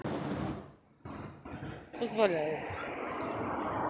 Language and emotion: Russian, neutral